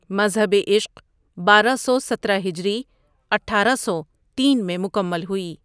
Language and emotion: Urdu, neutral